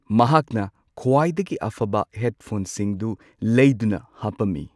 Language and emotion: Manipuri, neutral